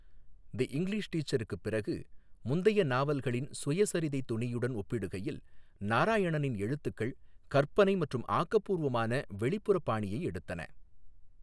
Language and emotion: Tamil, neutral